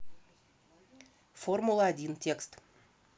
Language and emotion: Russian, neutral